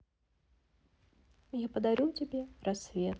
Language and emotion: Russian, neutral